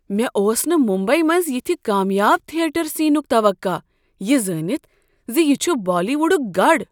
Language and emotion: Kashmiri, surprised